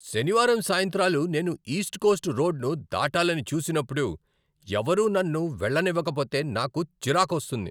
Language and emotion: Telugu, angry